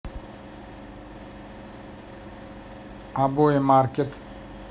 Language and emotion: Russian, neutral